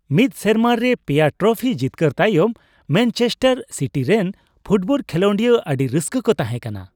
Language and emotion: Santali, happy